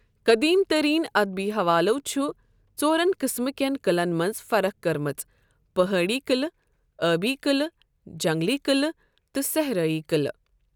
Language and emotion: Kashmiri, neutral